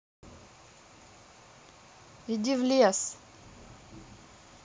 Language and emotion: Russian, angry